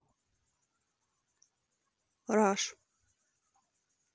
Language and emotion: Russian, neutral